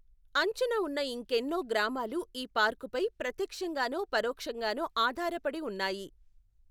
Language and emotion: Telugu, neutral